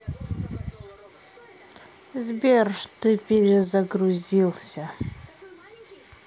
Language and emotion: Russian, angry